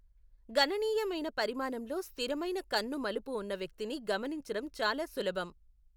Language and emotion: Telugu, neutral